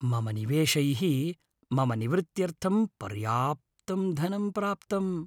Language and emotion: Sanskrit, happy